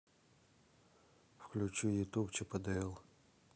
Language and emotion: Russian, neutral